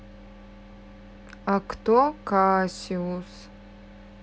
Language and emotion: Russian, neutral